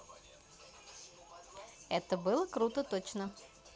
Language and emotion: Russian, positive